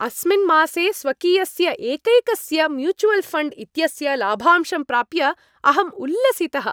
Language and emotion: Sanskrit, happy